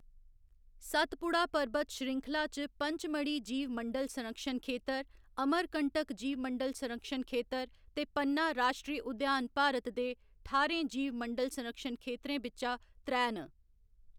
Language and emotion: Dogri, neutral